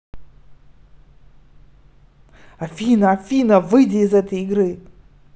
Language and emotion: Russian, neutral